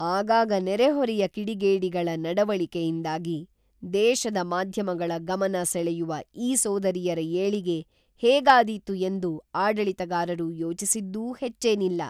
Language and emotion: Kannada, neutral